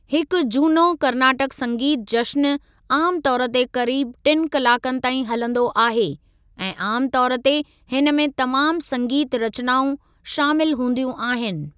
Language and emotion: Sindhi, neutral